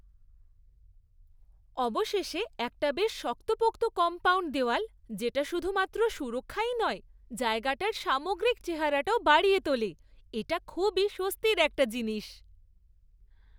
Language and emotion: Bengali, happy